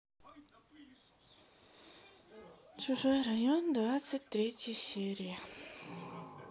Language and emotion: Russian, sad